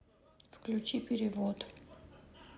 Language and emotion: Russian, neutral